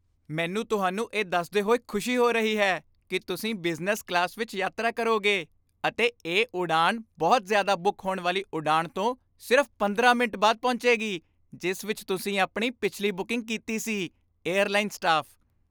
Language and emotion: Punjabi, happy